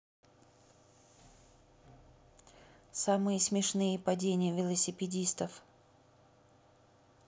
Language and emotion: Russian, neutral